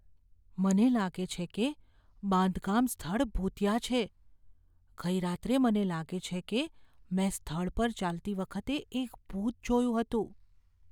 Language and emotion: Gujarati, fearful